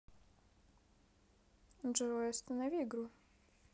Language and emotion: Russian, neutral